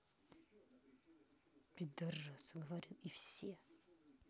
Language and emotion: Russian, angry